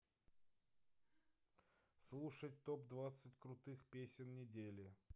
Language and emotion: Russian, neutral